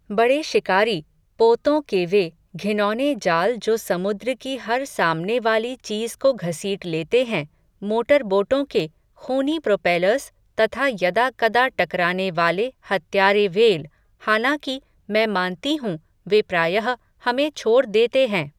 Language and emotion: Hindi, neutral